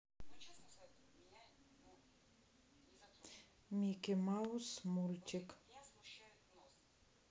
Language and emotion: Russian, neutral